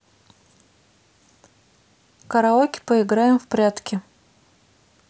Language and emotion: Russian, neutral